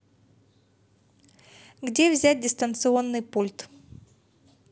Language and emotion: Russian, neutral